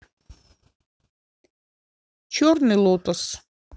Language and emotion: Russian, neutral